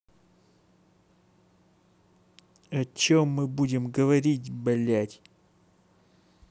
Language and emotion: Russian, angry